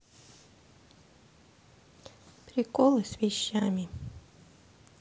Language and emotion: Russian, sad